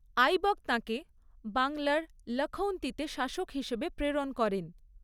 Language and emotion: Bengali, neutral